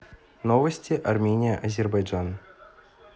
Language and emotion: Russian, neutral